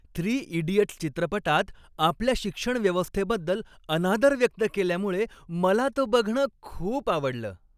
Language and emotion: Marathi, happy